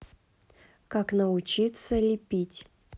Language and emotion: Russian, neutral